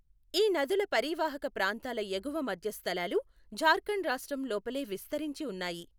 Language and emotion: Telugu, neutral